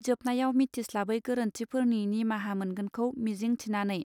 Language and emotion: Bodo, neutral